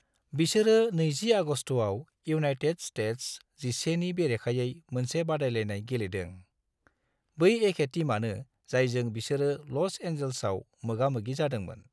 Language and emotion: Bodo, neutral